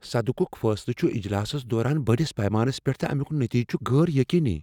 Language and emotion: Kashmiri, fearful